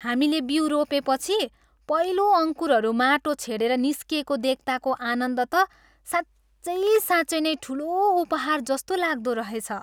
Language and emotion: Nepali, happy